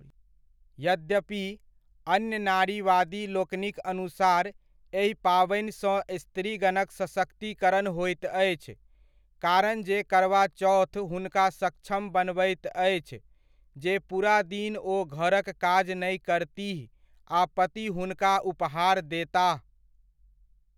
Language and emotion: Maithili, neutral